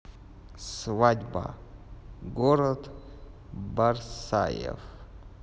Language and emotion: Russian, neutral